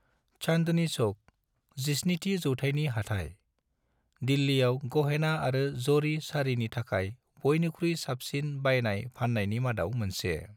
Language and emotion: Bodo, neutral